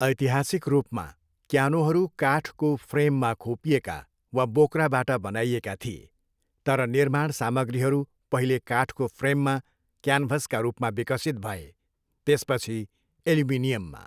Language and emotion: Nepali, neutral